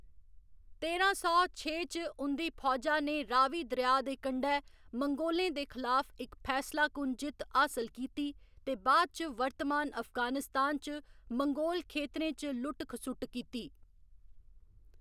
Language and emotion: Dogri, neutral